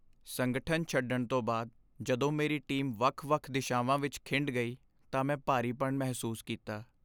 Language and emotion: Punjabi, sad